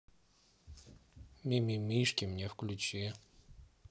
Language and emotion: Russian, neutral